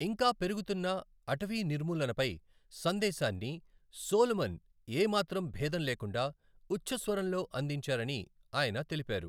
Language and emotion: Telugu, neutral